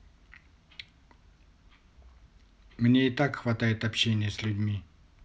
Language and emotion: Russian, neutral